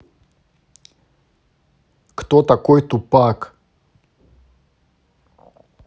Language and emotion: Russian, neutral